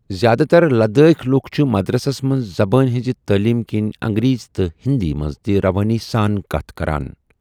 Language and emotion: Kashmiri, neutral